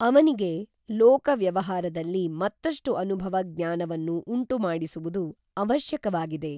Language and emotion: Kannada, neutral